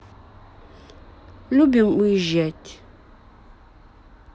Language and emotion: Russian, neutral